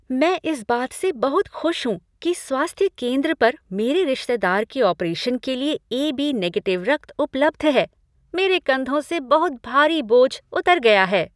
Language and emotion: Hindi, happy